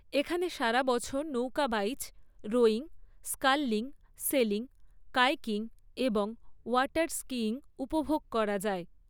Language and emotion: Bengali, neutral